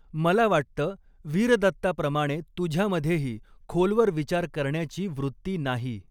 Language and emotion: Marathi, neutral